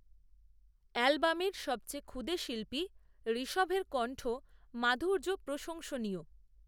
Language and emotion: Bengali, neutral